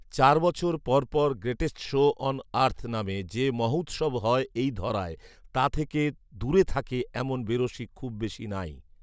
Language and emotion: Bengali, neutral